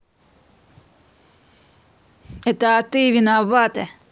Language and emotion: Russian, angry